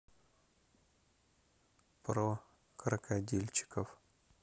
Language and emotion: Russian, neutral